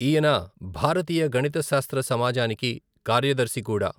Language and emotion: Telugu, neutral